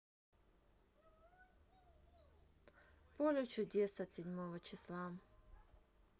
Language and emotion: Russian, neutral